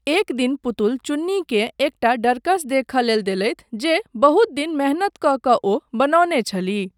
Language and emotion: Maithili, neutral